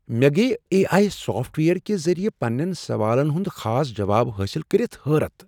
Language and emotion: Kashmiri, surprised